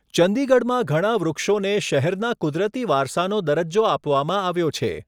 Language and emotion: Gujarati, neutral